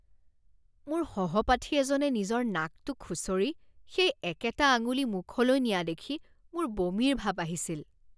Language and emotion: Assamese, disgusted